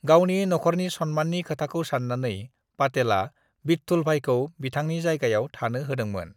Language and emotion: Bodo, neutral